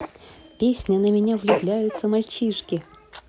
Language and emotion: Russian, positive